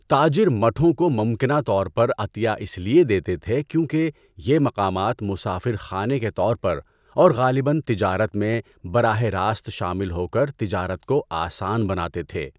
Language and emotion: Urdu, neutral